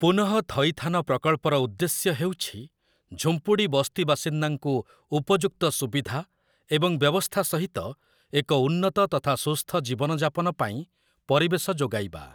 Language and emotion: Odia, neutral